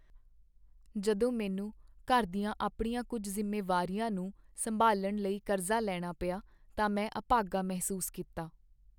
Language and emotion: Punjabi, sad